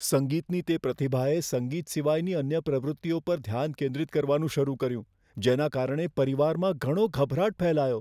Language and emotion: Gujarati, fearful